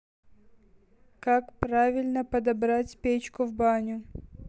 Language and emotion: Russian, neutral